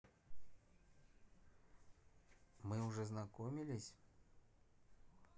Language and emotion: Russian, neutral